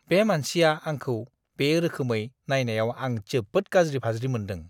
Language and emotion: Bodo, disgusted